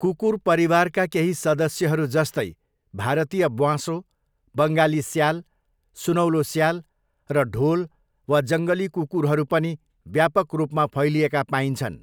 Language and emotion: Nepali, neutral